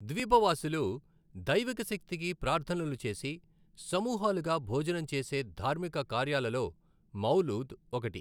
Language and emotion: Telugu, neutral